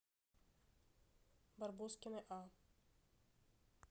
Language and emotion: Russian, neutral